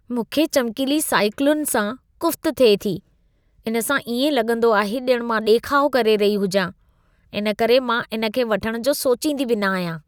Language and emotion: Sindhi, disgusted